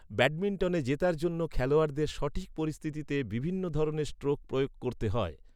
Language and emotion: Bengali, neutral